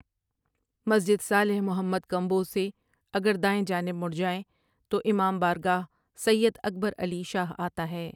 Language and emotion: Urdu, neutral